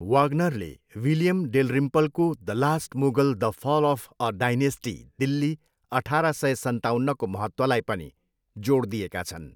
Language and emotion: Nepali, neutral